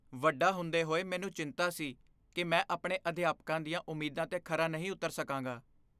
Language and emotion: Punjabi, fearful